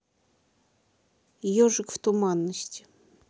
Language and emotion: Russian, neutral